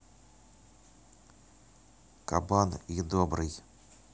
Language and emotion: Russian, neutral